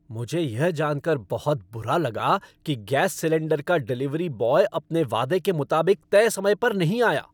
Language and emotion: Hindi, angry